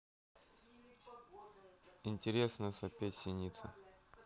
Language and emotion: Russian, neutral